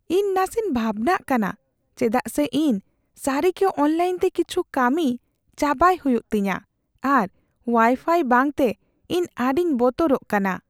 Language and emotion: Santali, fearful